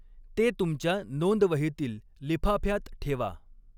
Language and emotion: Marathi, neutral